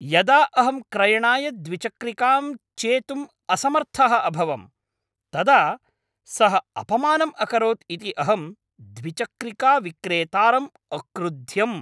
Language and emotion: Sanskrit, angry